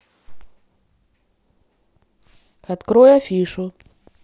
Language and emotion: Russian, neutral